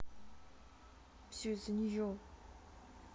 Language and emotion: Russian, sad